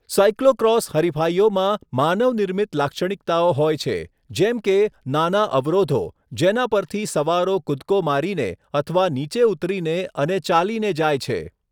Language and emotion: Gujarati, neutral